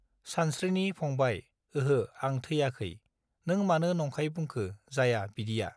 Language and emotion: Bodo, neutral